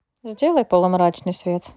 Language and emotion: Russian, neutral